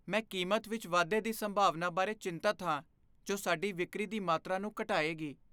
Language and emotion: Punjabi, fearful